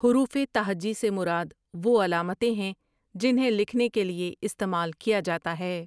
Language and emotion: Urdu, neutral